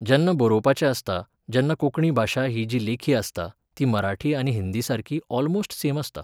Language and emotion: Goan Konkani, neutral